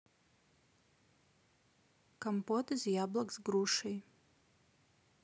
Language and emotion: Russian, neutral